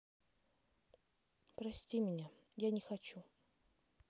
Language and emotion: Russian, sad